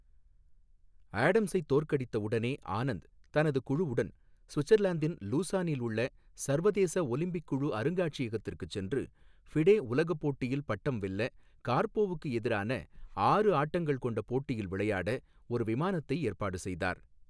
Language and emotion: Tamil, neutral